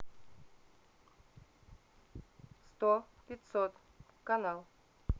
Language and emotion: Russian, neutral